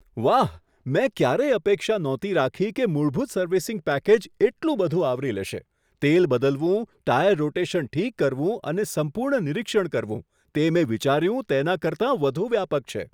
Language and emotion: Gujarati, surprised